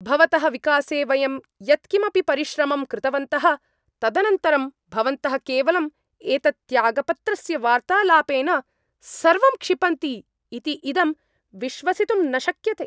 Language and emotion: Sanskrit, angry